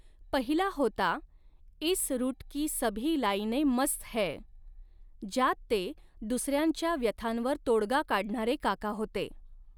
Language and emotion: Marathi, neutral